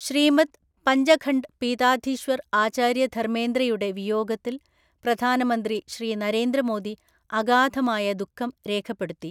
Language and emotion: Malayalam, neutral